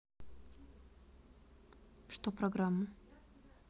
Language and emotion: Russian, neutral